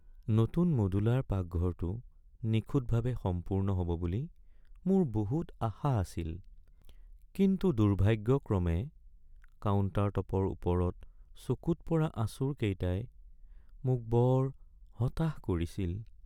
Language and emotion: Assamese, sad